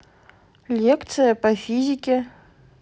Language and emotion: Russian, neutral